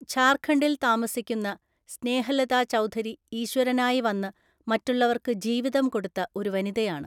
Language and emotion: Malayalam, neutral